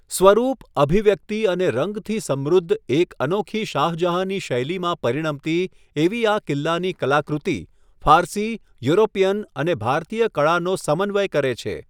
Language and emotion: Gujarati, neutral